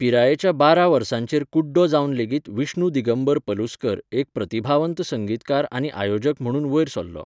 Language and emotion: Goan Konkani, neutral